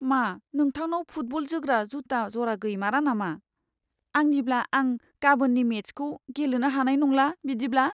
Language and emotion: Bodo, sad